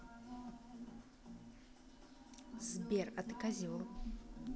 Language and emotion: Russian, neutral